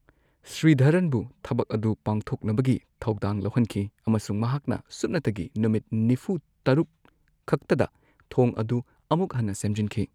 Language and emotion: Manipuri, neutral